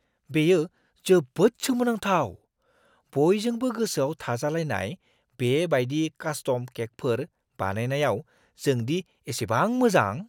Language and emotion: Bodo, surprised